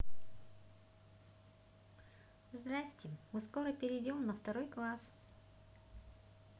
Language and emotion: Russian, positive